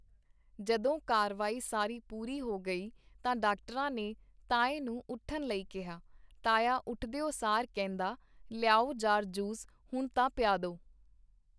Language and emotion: Punjabi, neutral